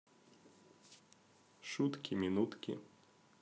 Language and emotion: Russian, neutral